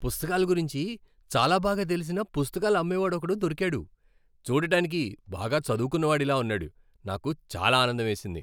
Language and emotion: Telugu, happy